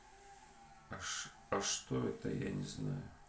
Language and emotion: Russian, sad